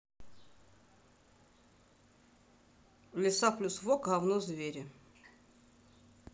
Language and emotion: Russian, neutral